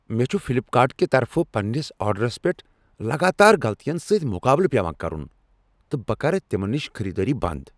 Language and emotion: Kashmiri, angry